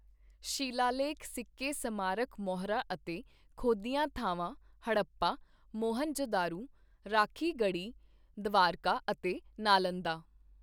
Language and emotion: Punjabi, neutral